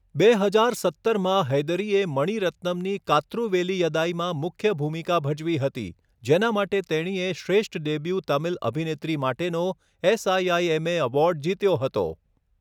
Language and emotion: Gujarati, neutral